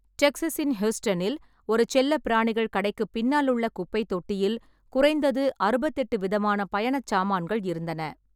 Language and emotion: Tamil, neutral